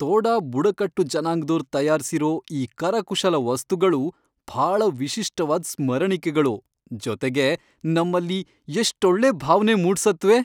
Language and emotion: Kannada, happy